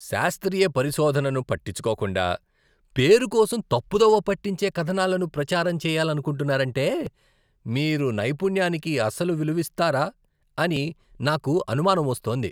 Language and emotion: Telugu, disgusted